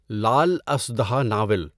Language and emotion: Urdu, neutral